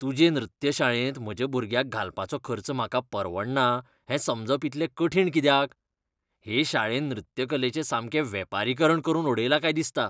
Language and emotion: Goan Konkani, disgusted